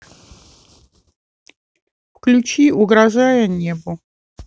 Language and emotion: Russian, neutral